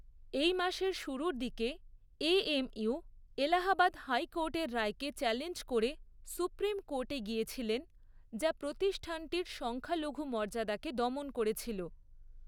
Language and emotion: Bengali, neutral